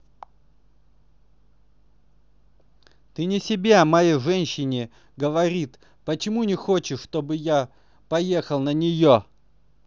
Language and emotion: Russian, angry